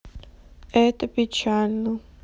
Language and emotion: Russian, sad